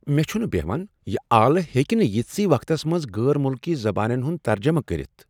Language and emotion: Kashmiri, surprised